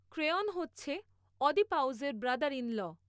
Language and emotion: Bengali, neutral